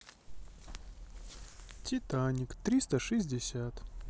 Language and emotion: Russian, sad